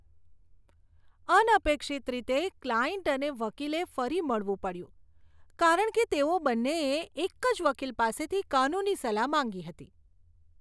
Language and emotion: Gujarati, disgusted